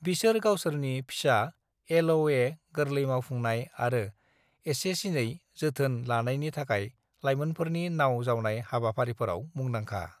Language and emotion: Bodo, neutral